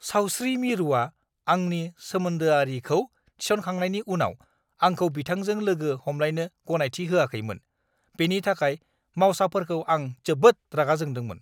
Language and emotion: Bodo, angry